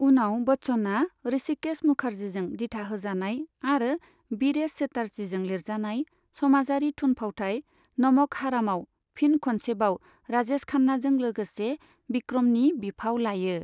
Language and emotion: Bodo, neutral